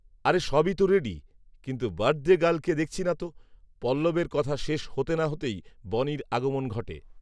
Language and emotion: Bengali, neutral